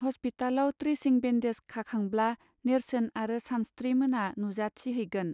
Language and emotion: Bodo, neutral